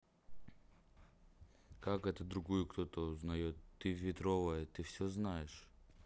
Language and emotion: Russian, neutral